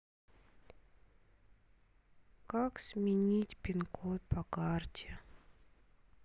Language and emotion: Russian, sad